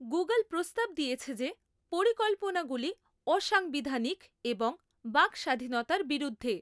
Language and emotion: Bengali, neutral